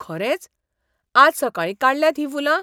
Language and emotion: Goan Konkani, surprised